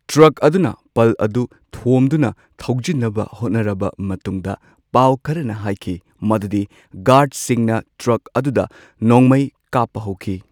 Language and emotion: Manipuri, neutral